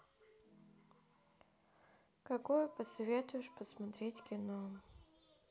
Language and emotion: Russian, sad